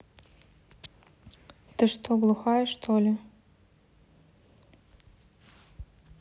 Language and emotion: Russian, angry